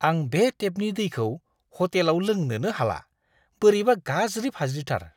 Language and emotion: Bodo, disgusted